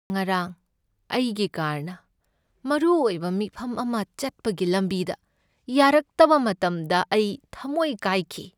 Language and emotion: Manipuri, sad